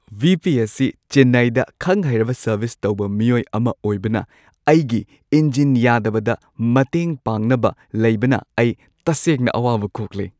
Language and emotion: Manipuri, happy